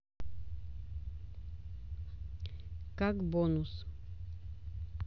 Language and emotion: Russian, neutral